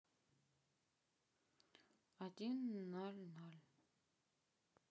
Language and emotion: Russian, neutral